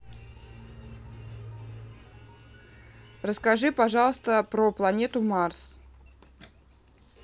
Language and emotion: Russian, neutral